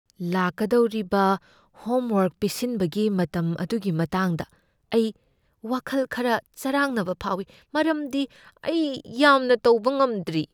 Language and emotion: Manipuri, fearful